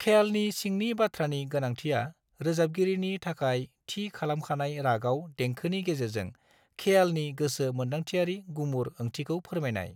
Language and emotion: Bodo, neutral